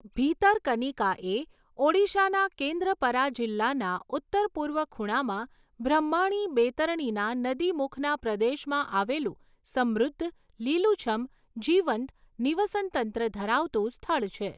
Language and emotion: Gujarati, neutral